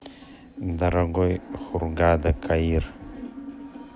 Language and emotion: Russian, neutral